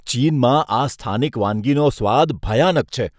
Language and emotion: Gujarati, disgusted